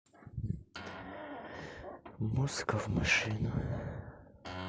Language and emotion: Russian, sad